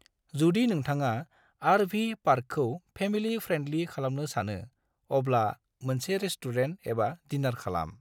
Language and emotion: Bodo, neutral